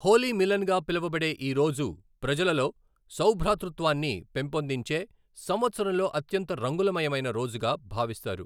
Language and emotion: Telugu, neutral